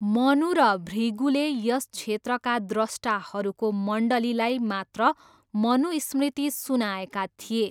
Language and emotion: Nepali, neutral